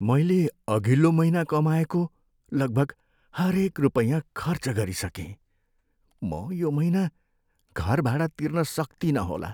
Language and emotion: Nepali, sad